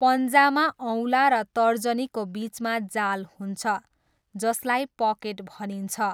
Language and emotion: Nepali, neutral